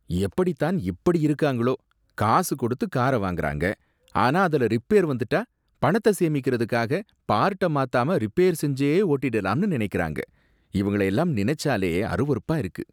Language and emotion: Tamil, disgusted